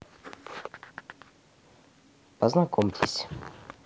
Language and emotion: Russian, neutral